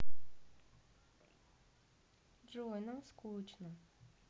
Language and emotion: Russian, sad